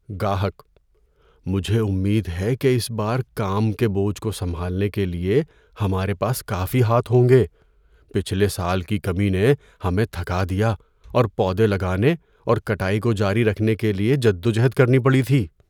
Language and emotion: Urdu, fearful